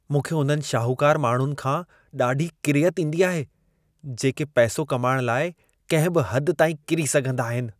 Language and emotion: Sindhi, disgusted